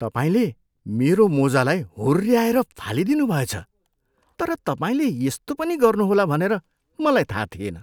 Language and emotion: Nepali, surprised